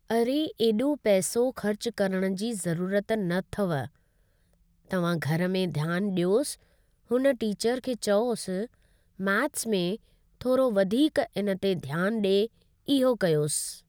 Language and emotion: Sindhi, neutral